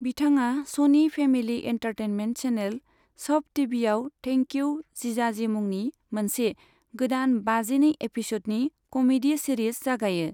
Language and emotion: Bodo, neutral